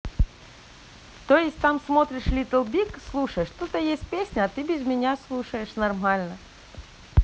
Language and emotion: Russian, neutral